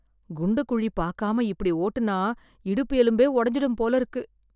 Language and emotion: Tamil, fearful